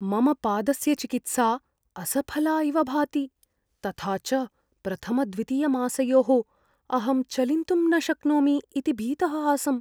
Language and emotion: Sanskrit, fearful